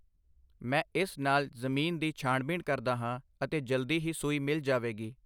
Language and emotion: Punjabi, neutral